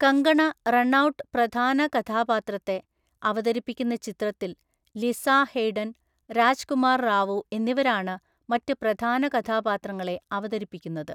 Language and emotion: Malayalam, neutral